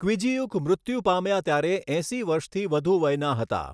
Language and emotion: Gujarati, neutral